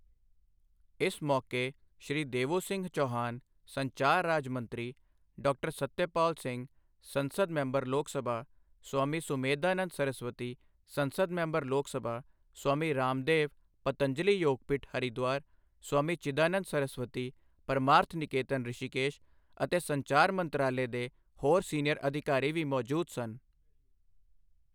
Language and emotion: Punjabi, neutral